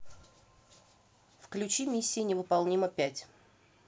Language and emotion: Russian, neutral